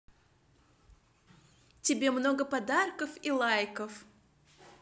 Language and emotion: Russian, neutral